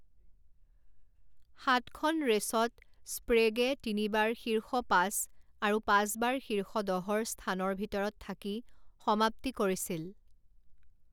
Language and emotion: Assamese, neutral